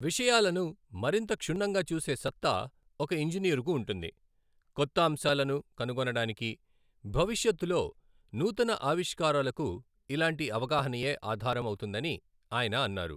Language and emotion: Telugu, neutral